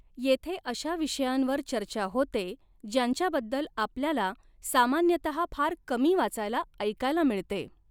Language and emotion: Marathi, neutral